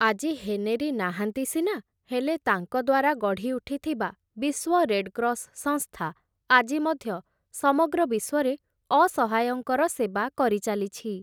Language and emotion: Odia, neutral